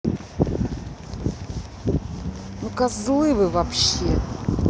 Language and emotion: Russian, angry